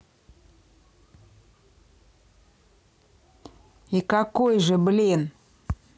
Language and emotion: Russian, angry